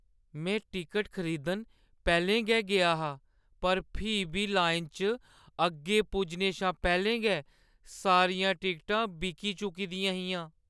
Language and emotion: Dogri, sad